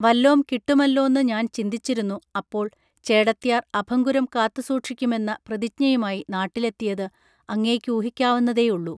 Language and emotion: Malayalam, neutral